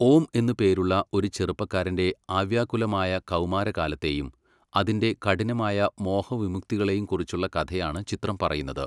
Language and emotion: Malayalam, neutral